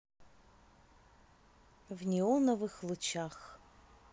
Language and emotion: Russian, positive